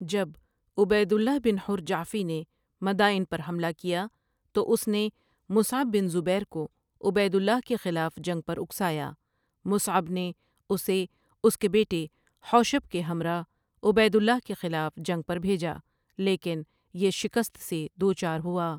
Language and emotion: Urdu, neutral